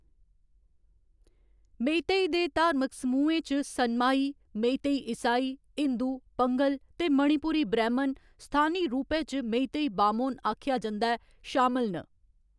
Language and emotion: Dogri, neutral